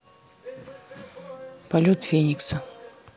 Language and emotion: Russian, neutral